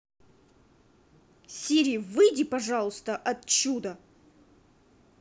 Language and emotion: Russian, angry